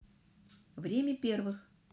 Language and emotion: Russian, neutral